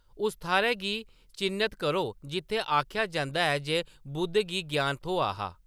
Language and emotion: Dogri, neutral